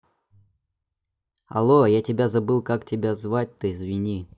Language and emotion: Russian, neutral